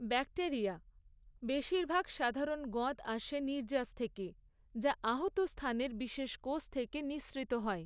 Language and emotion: Bengali, neutral